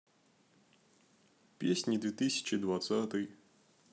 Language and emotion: Russian, neutral